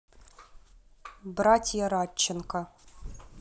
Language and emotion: Russian, neutral